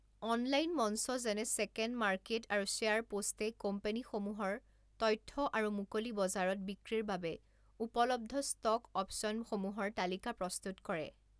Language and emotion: Assamese, neutral